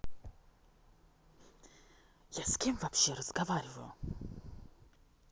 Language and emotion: Russian, angry